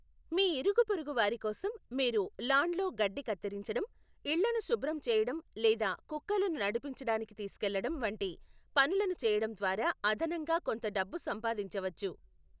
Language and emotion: Telugu, neutral